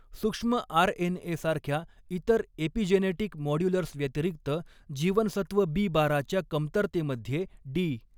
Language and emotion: Marathi, neutral